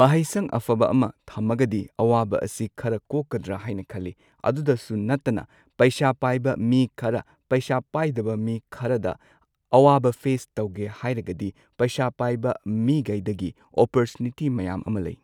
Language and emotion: Manipuri, neutral